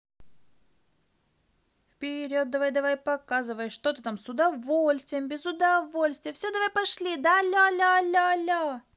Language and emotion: Russian, positive